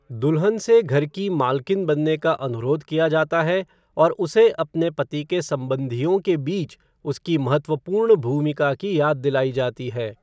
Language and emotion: Hindi, neutral